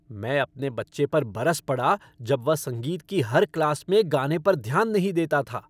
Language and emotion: Hindi, angry